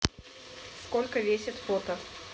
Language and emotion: Russian, neutral